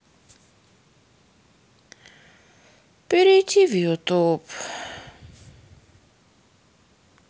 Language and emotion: Russian, sad